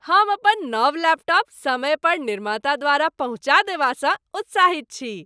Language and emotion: Maithili, happy